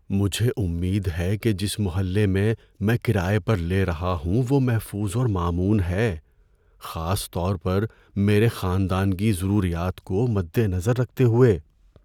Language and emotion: Urdu, fearful